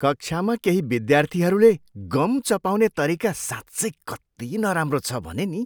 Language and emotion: Nepali, disgusted